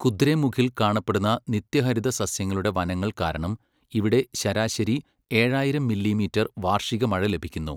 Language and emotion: Malayalam, neutral